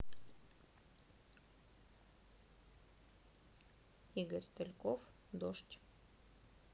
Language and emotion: Russian, neutral